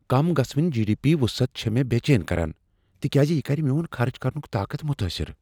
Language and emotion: Kashmiri, fearful